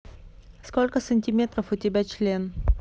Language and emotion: Russian, neutral